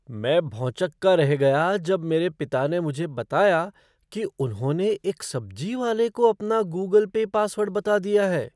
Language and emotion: Hindi, surprised